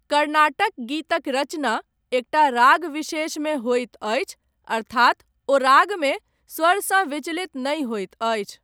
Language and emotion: Maithili, neutral